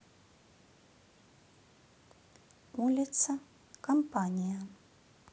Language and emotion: Russian, neutral